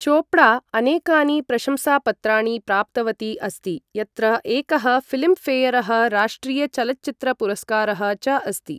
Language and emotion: Sanskrit, neutral